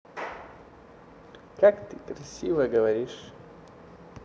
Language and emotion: Russian, neutral